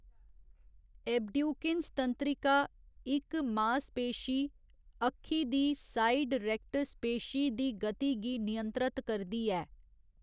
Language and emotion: Dogri, neutral